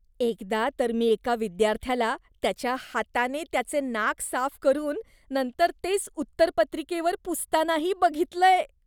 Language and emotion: Marathi, disgusted